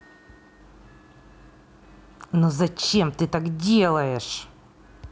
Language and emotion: Russian, angry